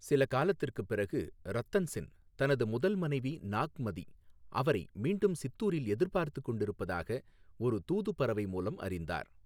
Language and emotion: Tamil, neutral